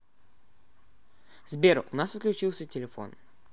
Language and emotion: Russian, neutral